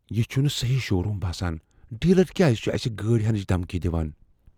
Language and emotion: Kashmiri, fearful